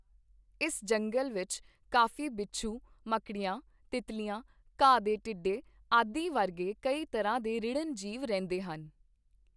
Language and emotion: Punjabi, neutral